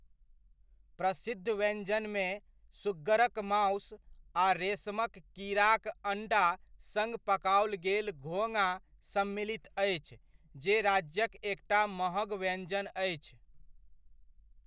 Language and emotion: Maithili, neutral